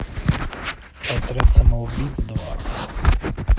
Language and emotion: Russian, neutral